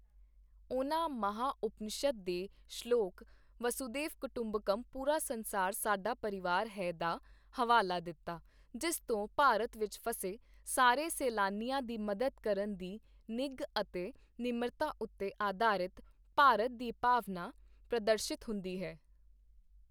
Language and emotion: Punjabi, neutral